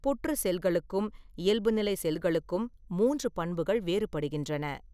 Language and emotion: Tamil, neutral